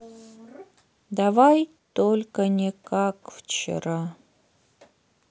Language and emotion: Russian, sad